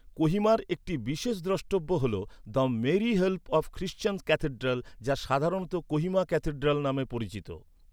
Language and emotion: Bengali, neutral